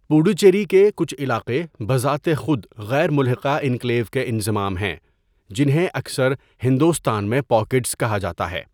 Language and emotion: Urdu, neutral